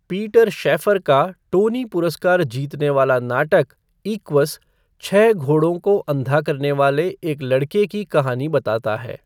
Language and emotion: Hindi, neutral